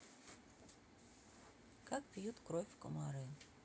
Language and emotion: Russian, neutral